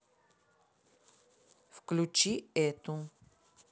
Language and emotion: Russian, neutral